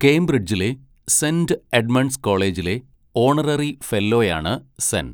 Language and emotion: Malayalam, neutral